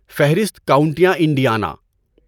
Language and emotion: Urdu, neutral